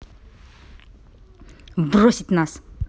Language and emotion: Russian, angry